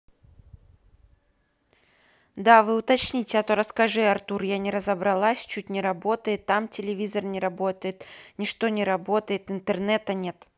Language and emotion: Russian, neutral